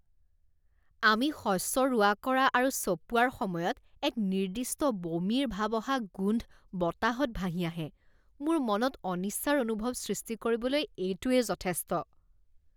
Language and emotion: Assamese, disgusted